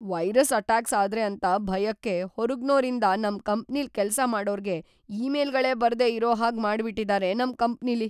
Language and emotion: Kannada, fearful